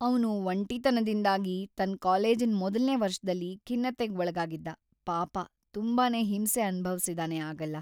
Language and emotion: Kannada, sad